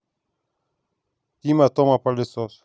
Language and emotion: Russian, neutral